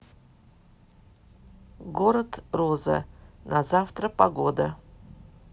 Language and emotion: Russian, neutral